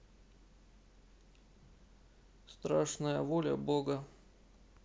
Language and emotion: Russian, neutral